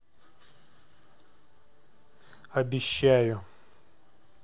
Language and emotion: Russian, neutral